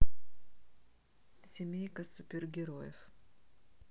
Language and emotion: Russian, neutral